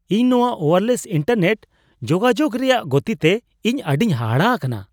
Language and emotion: Santali, surprised